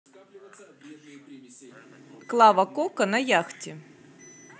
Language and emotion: Russian, positive